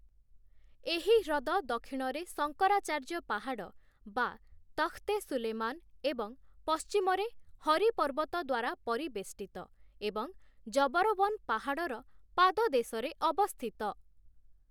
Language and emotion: Odia, neutral